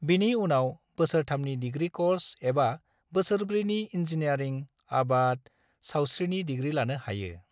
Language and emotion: Bodo, neutral